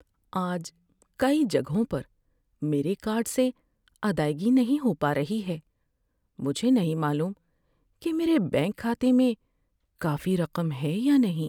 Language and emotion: Urdu, sad